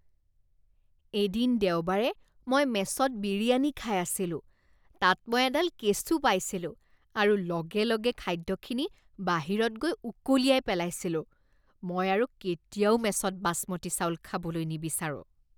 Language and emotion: Assamese, disgusted